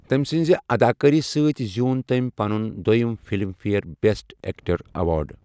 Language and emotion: Kashmiri, neutral